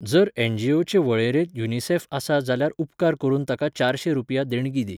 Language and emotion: Goan Konkani, neutral